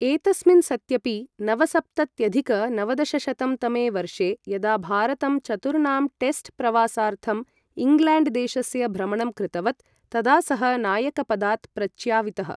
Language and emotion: Sanskrit, neutral